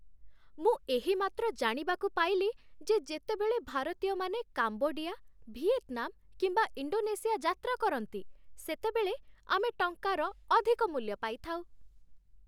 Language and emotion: Odia, happy